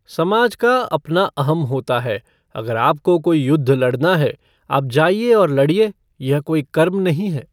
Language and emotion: Hindi, neutral